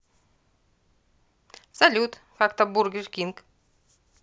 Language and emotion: Russian, positive